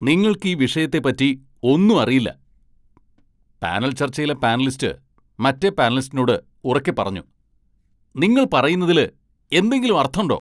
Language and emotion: Malayalam, angry